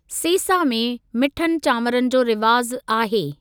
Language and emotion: Sindhi, neutral